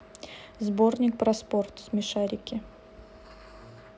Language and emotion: Russian, neutral